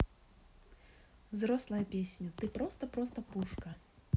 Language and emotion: Russian, neutral